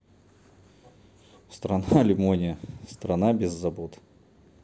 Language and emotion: Russian, neutral